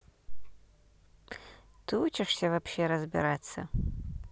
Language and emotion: Russian, neutral